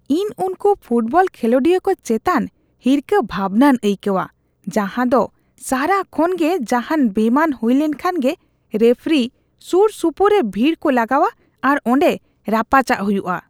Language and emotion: Santali, disgusted